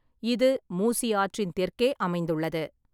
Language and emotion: Tamil, neutral